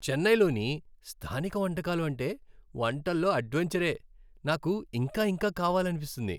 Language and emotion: Telugu, happy